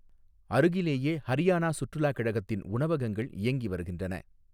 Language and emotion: Tamil, neutral